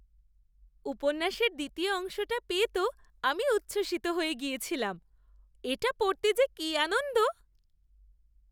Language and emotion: Bengali, happy